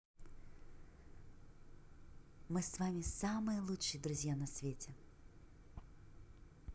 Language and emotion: Russian, positive